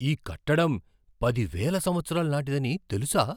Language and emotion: Telugu, surprised